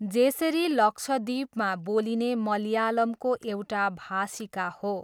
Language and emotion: Nepali, neutral